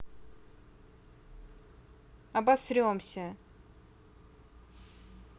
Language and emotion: Russian, angry